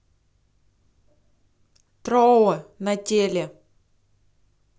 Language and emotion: Russian, neutral